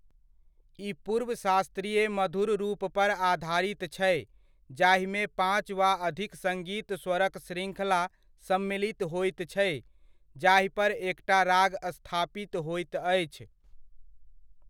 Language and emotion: Maithili, neutral